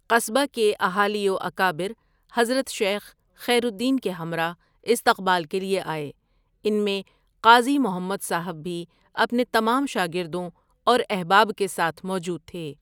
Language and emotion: Urdu, neutral